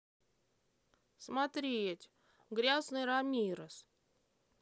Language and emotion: Russian, neutral